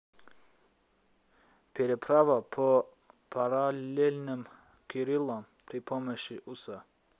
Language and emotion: Russian, neutral